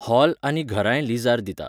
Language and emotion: Goan Konkani, neutral